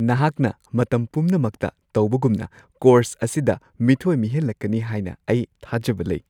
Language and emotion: Manipuri, happy